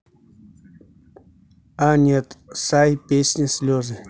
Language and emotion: Russian, neutral